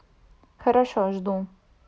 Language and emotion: Russian, neutral